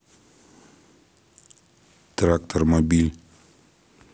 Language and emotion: Russian, neutral